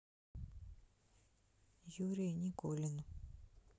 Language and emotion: Russian, sad